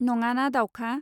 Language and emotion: Bodo, neutral